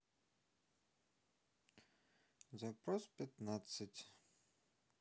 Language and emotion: Russian, neutral